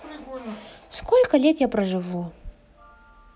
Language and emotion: Russian, neutral